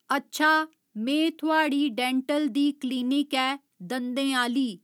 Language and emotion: Dogri, neutral